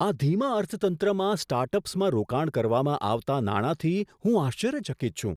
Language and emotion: Gujarati, surprised